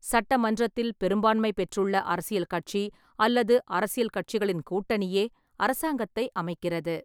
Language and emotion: Tamil, neutral